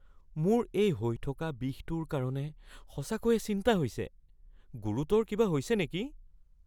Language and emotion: Assamese, fearful